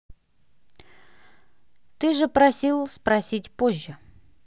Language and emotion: Russian, neutral